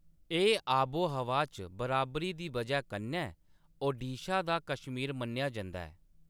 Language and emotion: Dogri, neutral